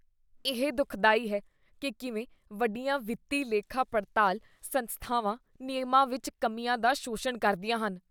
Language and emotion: Punjabi, disgusted